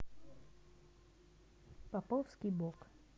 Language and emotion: Russian, neutral